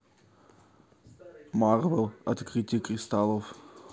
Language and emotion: Russian, neutral